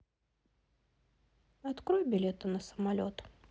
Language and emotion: Russian, neutral